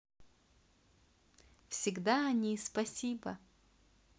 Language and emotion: Russian, positive